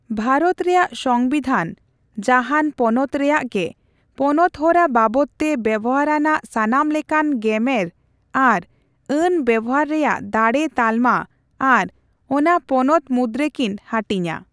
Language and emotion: Santali, neutral